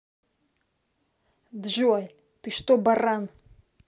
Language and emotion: Russian, angry